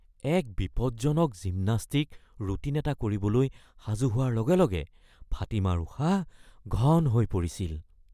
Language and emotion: Assamese, fearful